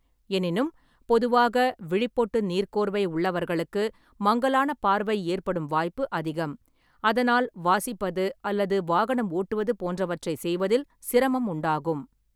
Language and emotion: Tamil, neutral